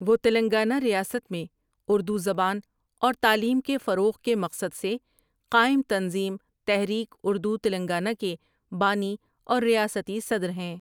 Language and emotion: Urdu, neutral